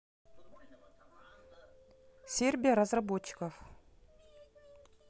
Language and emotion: Russian, neutral